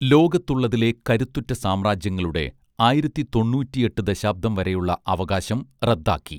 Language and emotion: Malayalam, neutral